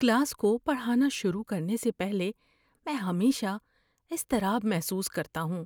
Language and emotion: Urdu, fearful